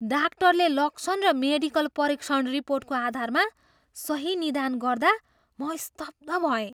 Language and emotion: Nepali, surprised